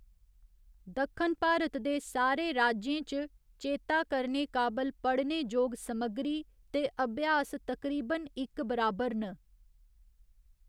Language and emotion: Dogri, neutral